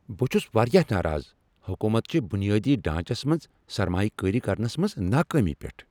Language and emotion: Kashmiri, angry